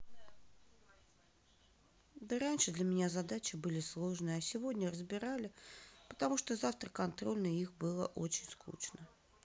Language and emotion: Russian, sad